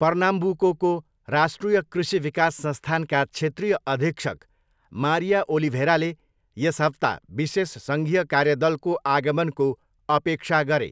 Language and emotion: Nepali, neutral